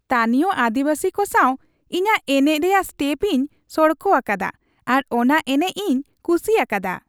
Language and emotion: Santali, happy